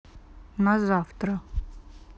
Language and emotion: Russian, neutral